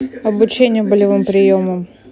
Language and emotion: Russian, neutral